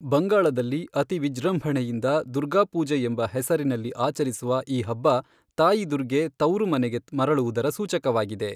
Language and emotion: Kannada, neutral